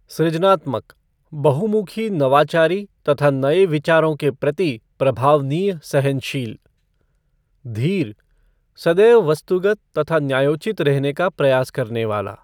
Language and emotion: Hindi, neutral